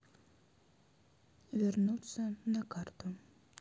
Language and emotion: Russian, neutral